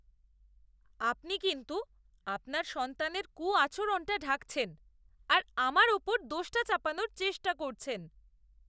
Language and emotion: Bengali, disgusted